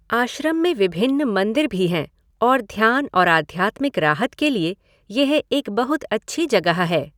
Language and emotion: Hindi, neutral